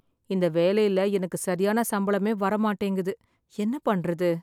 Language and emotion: Tamil, sad